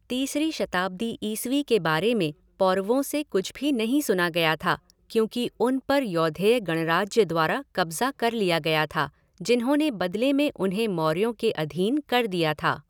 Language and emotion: Hindi, neutral